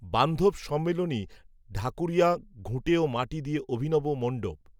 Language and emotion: Bengali, neutral